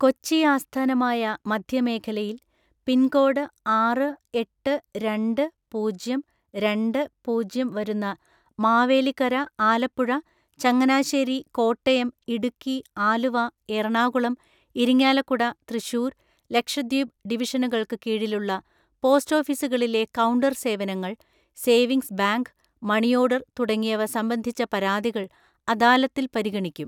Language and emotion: Malayalam, neutral